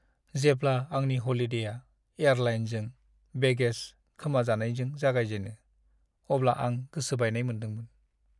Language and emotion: Bodo, sad